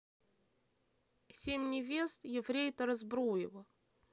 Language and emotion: Russian, neutral